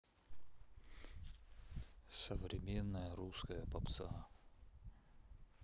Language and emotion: Russian, neutral